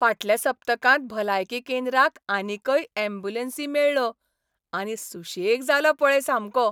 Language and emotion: Goan Konkani, happy